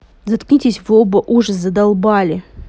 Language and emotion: Russian, angry